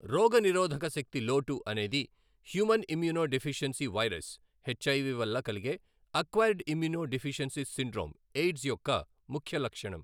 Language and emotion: Telugu, neutral